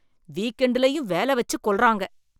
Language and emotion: Tamil, angry